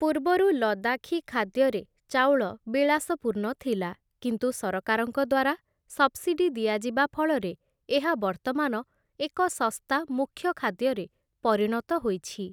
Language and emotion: Odia, neutral